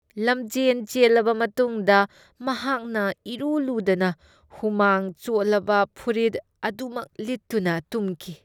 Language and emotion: Manipuri, disgusted